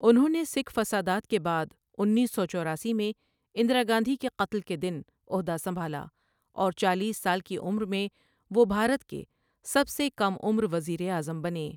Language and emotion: Urdu, neutral